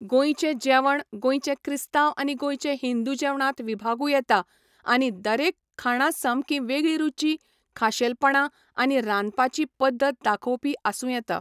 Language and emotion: Goan Konkani, neutral